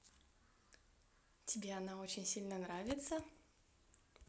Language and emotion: Russian, positive